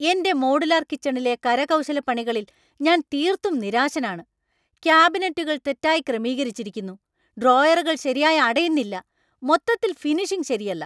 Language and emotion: Malayalam, angry